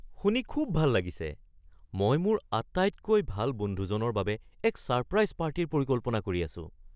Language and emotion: Assamese, surprised